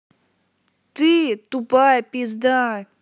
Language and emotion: Russian, angry